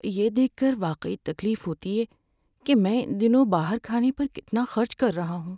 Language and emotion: Urdu, sad